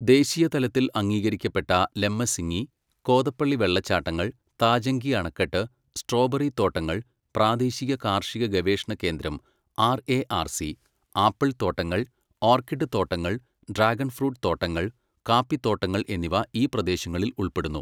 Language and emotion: Malayalam, neutral